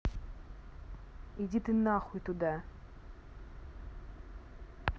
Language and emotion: Russian, angry